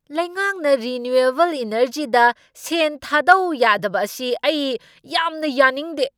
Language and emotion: Manipuri, angry